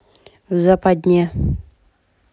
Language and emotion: Russian, neutral